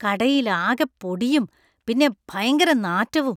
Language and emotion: Malayalam, disgusted